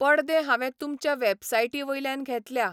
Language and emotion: Goan Konkani, neutral